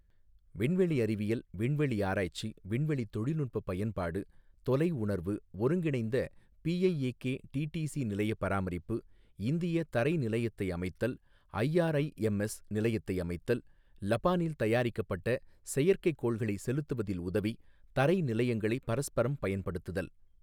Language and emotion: Tamil, neutral